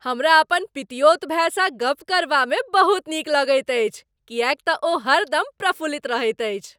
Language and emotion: Maithili, happy